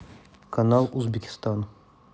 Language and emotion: Russian, neutral